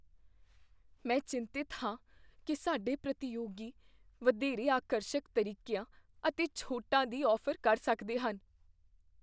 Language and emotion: Punjabi, fearful